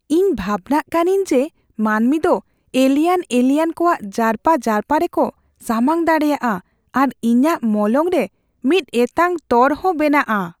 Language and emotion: Santali, fearful